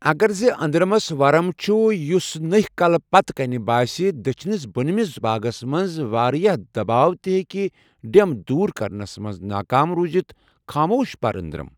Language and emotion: Kashmiri, neutral